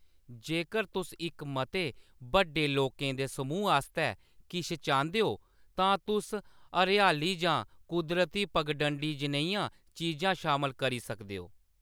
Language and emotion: Dogri, neutral